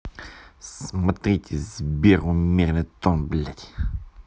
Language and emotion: Russian, angry